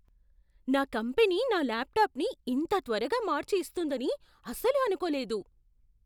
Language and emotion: Telugu, surprised